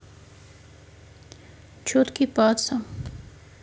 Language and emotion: Russian, neutral